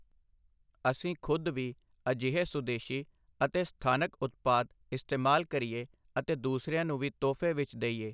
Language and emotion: Punjabi, neutral